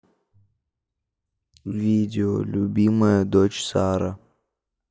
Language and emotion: Russian, sad